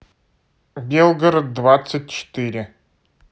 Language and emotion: Russian, neutral